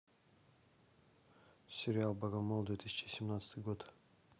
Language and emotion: Russian, neutral